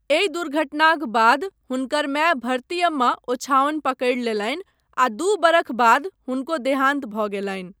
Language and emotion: Maithili, neutral